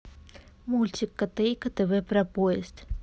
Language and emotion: Russian, neutral